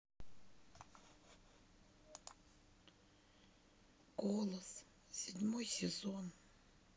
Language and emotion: Russian, neutral